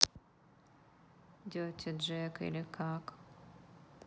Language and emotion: Russian, sad